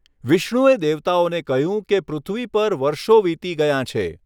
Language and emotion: Gujarati, neutral